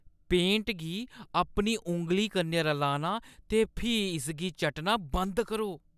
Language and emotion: Dogri, disgusted